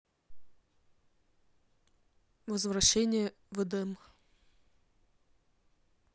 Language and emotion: Russian, neutral